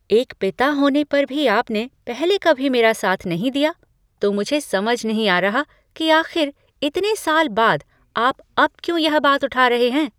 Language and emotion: Hindi, surprised